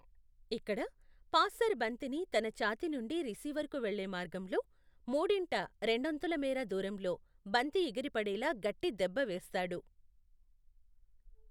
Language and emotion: Telugu, neutral